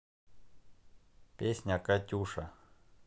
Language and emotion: Russian, neutral